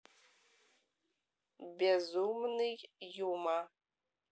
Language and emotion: Russian, neutral